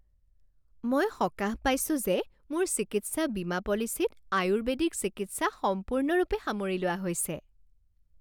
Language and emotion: Assamese, happy